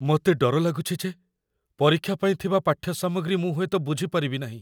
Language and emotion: Odia, fearful